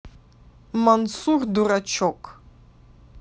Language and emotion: Russian, neutral